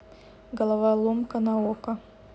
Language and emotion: Russian, neutral